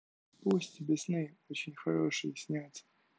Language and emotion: Russian, neutral